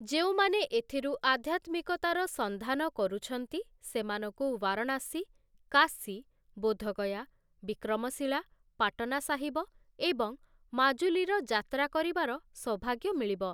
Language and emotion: Odia, neutral